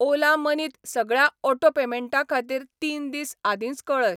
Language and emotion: Goan Konkani, neutral